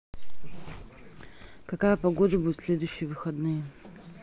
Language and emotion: Russian, neutral